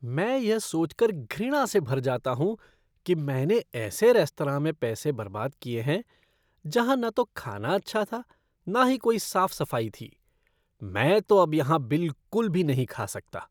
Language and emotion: Hindi, disgusted